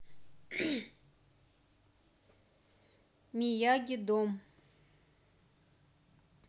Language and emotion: Russian, neutral